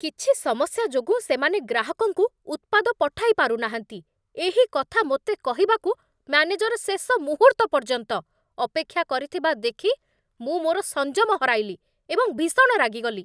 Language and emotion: Odia, angry